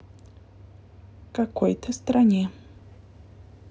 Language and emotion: Russian, neutral